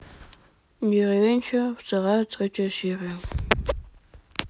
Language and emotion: Russian, neutral